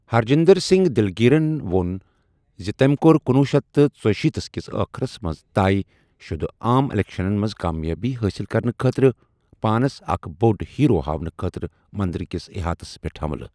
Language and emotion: Kashmiri, neutral